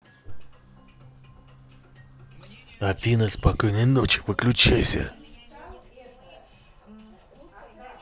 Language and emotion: Russian, angry